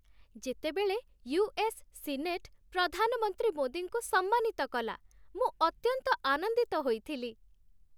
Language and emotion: Odia, happy